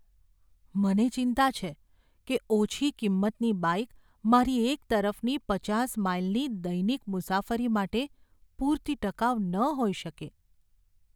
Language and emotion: Gujarati, fearful